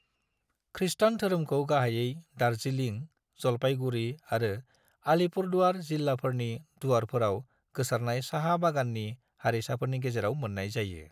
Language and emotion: Bodo, neutral